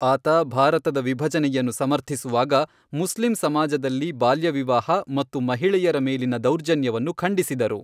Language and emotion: Kannada, neutral